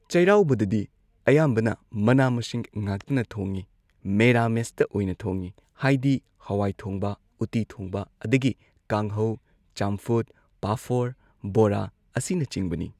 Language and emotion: Manipuri, neutral